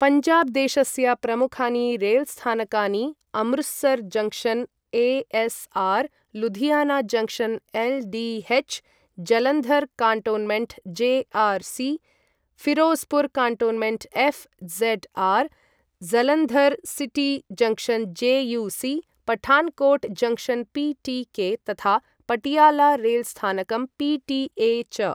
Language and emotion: Sanskrit, neutral